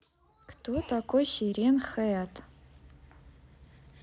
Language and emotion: Russian, neutral